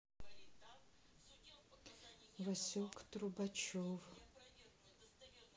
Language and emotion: Russian, sad